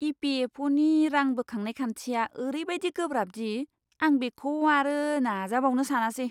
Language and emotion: Bodo, disgusted